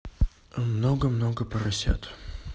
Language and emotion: Russian, neutral